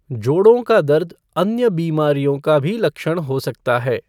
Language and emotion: Hindi, neutral